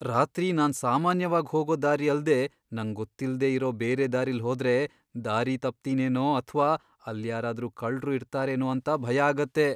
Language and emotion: Kannada, fearful